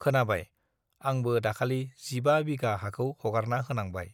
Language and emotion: Bodo, neutral